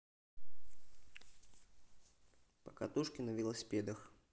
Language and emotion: Russian, neutral